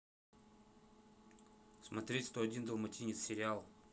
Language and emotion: Russian, neutral